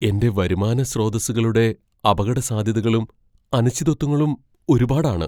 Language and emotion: Malayalam, fearful